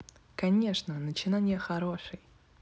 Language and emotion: Russian, positive